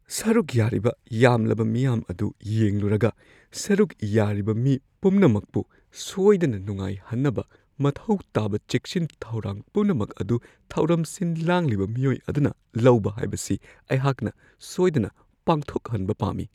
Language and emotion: Manipuri, fearful